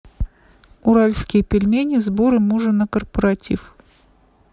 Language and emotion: Russian, neutral